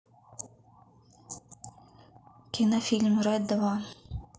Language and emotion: Russian, neutral